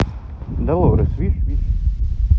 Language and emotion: Russian, neutral